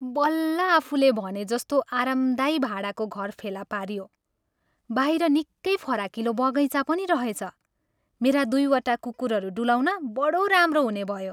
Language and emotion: Nepali, happy